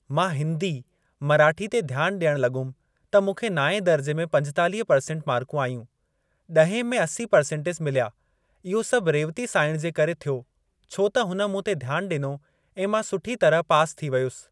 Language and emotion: Sindhi, neutral